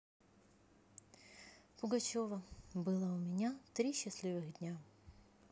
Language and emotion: Russian, neutral